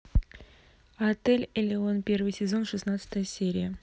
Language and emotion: Russian, neutral